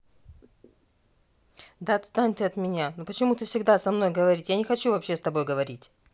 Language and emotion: Russian, angry